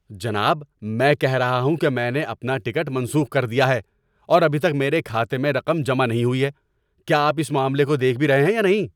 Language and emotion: Urdu, angry